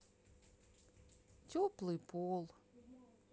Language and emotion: Russian, sad